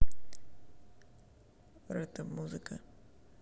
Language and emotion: Russian, neutral